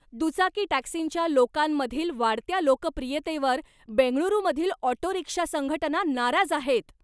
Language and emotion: Marathi, angry